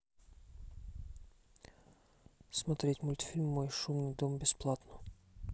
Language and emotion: Russian, neutral